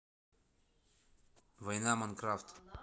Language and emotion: Russian, neutral